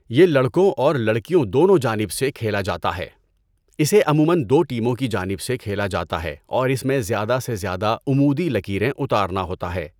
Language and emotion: Urdu, neutral